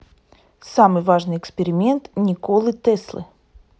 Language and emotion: Russian, neutral